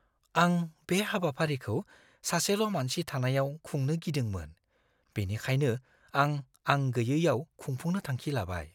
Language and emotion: Bodo, fearful